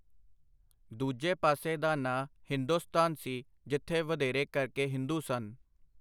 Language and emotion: Punjabi, neutral